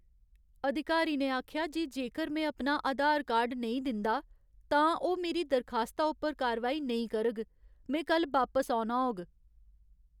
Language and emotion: Dogri, sad